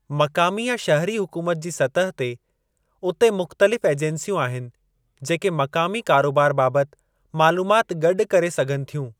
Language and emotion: Sindhi, neutral